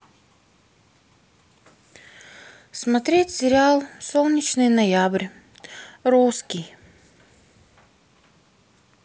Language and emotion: Russian, sad